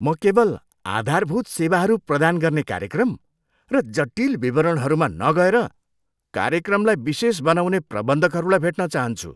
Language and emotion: Nepali, disgusted